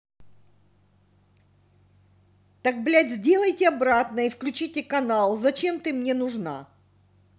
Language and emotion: Russian, angry